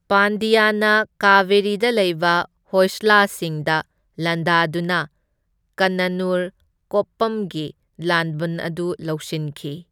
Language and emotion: Manipuri, neutral